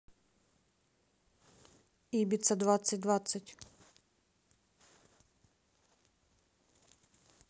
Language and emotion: Russian, neutral